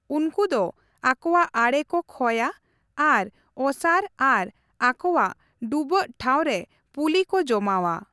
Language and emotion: Santali, neutral